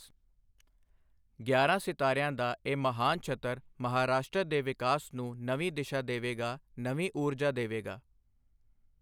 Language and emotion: Punjabi, neutral